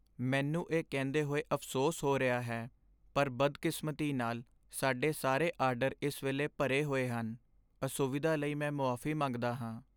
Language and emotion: Punjabi, sad